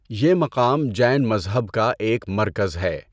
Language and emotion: Urdu, neutral